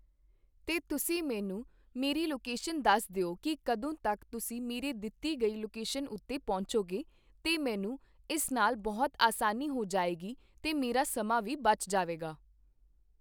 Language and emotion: Punjabi, neutral